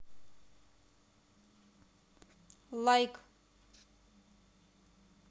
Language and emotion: Russian, neutral